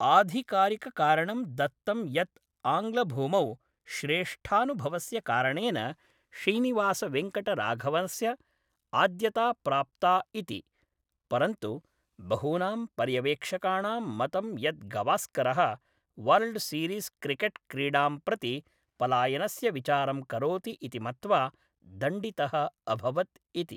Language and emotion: Sanskrit, neutral